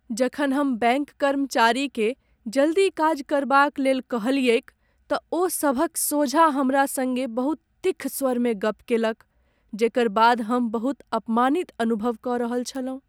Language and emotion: Maithili, sad